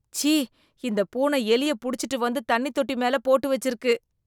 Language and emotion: Tamil, disgusted